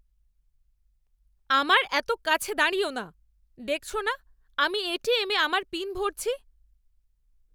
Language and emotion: Bengali, angry